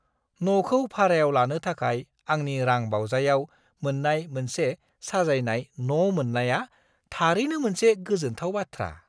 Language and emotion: Bodo, surprised